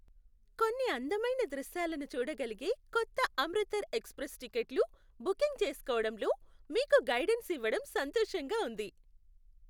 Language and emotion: Telugu, happy